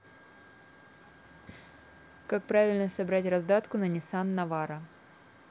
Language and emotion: Russian, neutral